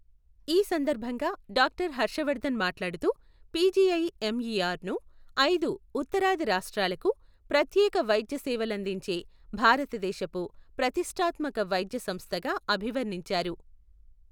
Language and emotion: Telugu, neutral